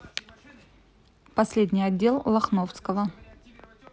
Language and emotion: Russian, neutral